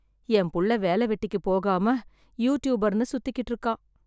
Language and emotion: Tamil, sad